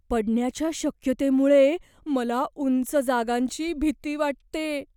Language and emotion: Marathi, fearful